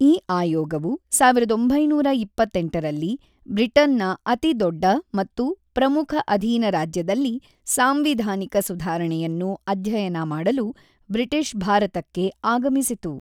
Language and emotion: Kannada, neutral